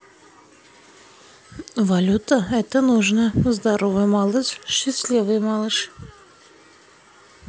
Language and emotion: Russian, neutral